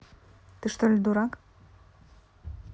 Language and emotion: Russian, neutral